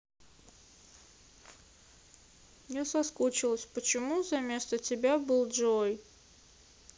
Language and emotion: Russian, sad